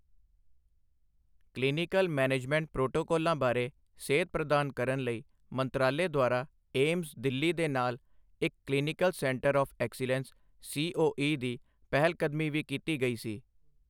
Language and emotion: Punjabi, neutral